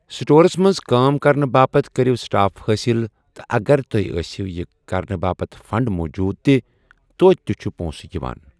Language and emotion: Kashmiri, neutral